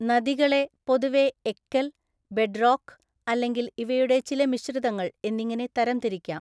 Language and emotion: Malayalam, neutral